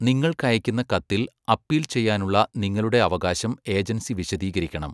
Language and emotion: Malayalam, neutral